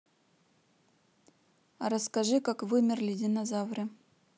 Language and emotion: Russian, neutral